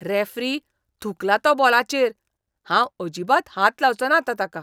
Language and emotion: Goan Konkani, disgusted